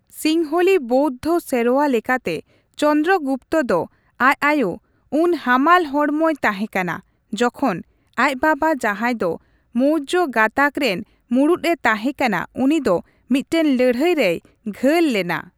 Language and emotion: Santali, neutral